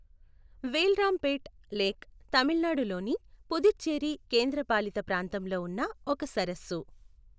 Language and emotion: Telugu, neutral